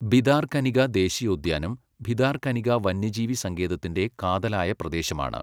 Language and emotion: Malayalam, neutral